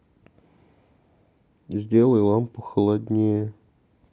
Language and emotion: Russian, neutral